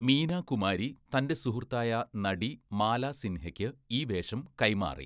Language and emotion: Malayalam, neutral